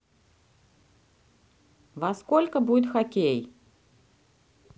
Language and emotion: Russian, neutral